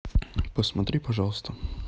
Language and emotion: Russian, neutral